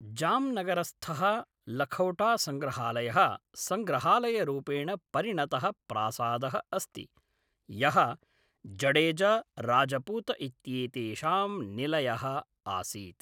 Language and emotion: Sanskrit, neutral